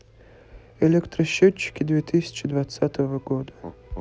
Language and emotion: Russian, neutral